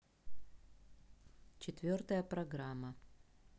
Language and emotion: Russian, neutral